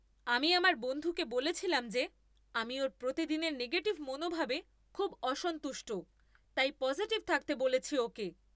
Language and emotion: Bengali, angry